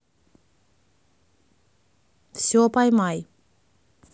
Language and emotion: Russian, neutral